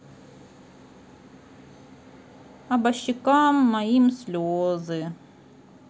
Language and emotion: Russian, sad